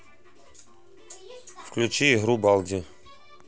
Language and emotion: Russian, neutral